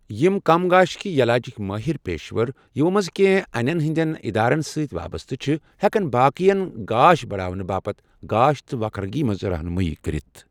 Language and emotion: Kashmiri, neutral